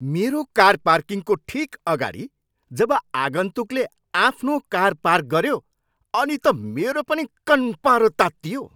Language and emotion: Nepali, angry